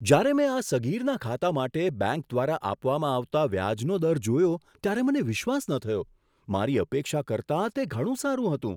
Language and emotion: Gujarati, surprised